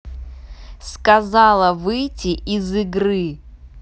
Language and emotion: Russian, angry